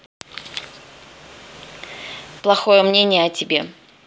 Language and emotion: Russian, neutral